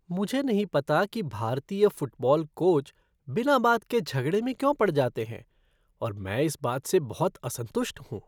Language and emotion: Hindi, disgusted